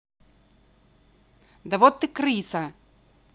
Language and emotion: Russian, angry